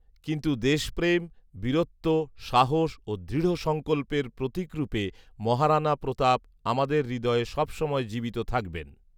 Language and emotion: Bengali, neutral